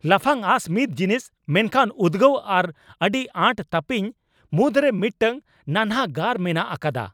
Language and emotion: Santali, angry